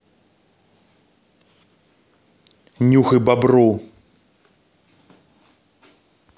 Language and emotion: Russian, angry